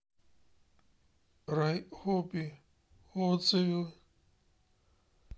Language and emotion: Russian, sad